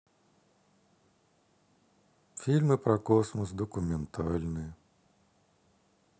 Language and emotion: Russian, sad